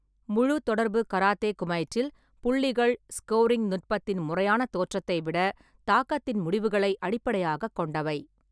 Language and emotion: Tamil, neutral